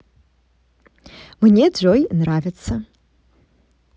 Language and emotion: Russian, positive